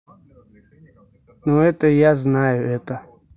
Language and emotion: Russian, neutral